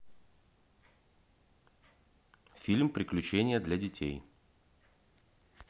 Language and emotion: Russian, neutral